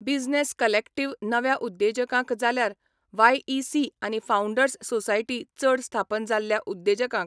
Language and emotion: Goan Konkani, neutral